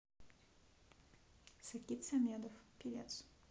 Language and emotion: Russian, neutral